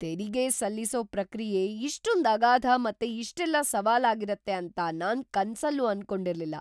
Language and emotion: Kannada, surprised